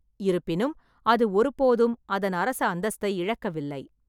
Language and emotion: Tamil, neutral